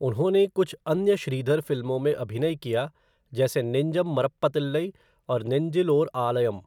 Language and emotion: Hindi, neutral